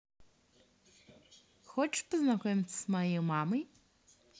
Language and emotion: Russian, positive